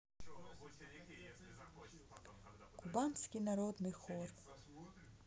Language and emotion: Russian, neutral